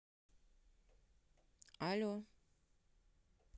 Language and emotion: Russian, neutral